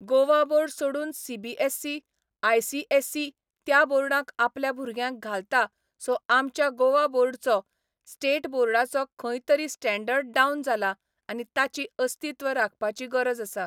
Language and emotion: Goan Konkani, neutral